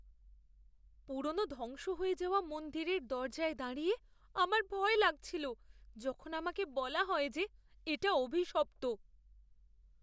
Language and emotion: Bengali, fearful